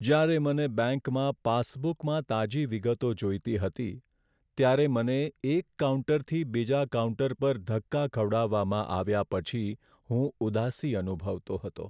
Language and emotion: Gujarati, sad